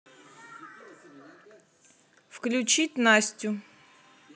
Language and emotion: Russian, neutral